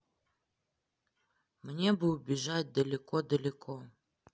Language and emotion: Russian, sad